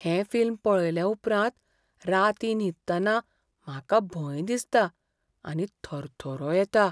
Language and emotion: Goan Konkani, fearful